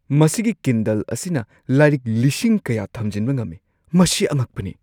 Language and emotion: Manipuri, surprised